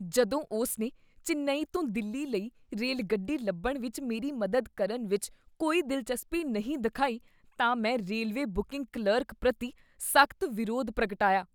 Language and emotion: Punjabi, disgusted